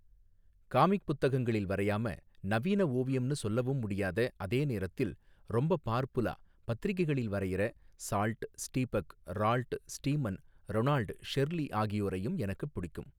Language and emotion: Tamil, neutral